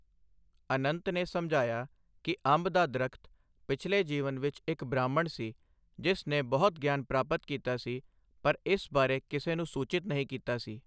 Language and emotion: Punjabi, neutral